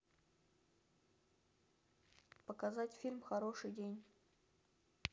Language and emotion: Russian, neutral